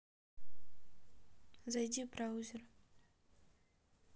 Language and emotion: Russian, neutral